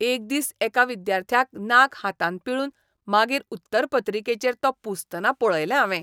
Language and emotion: Goan Konkani, disgusted